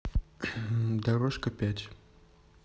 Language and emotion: Russian, neutral